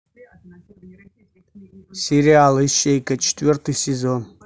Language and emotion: Russian, neutral